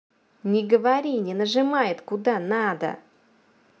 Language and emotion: Russian, angry